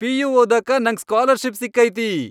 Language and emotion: Kannada, happy